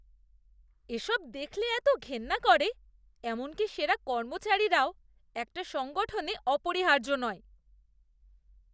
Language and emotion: Bengali, disgusted